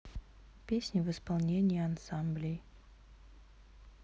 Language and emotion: Russian, neutral